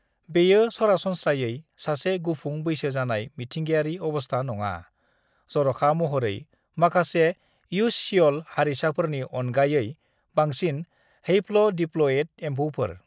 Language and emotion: Bodo, neutral